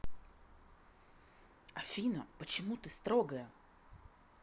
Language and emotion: Russian, angry